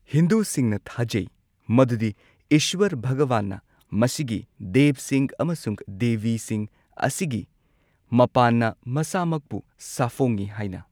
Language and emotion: Manipuri, neutral